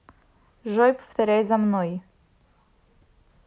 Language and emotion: Russian, neutral